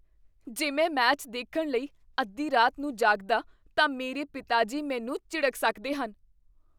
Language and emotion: Punjabi, fearful